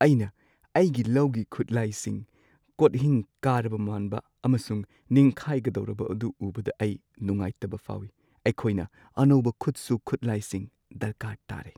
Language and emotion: Manipuri, sad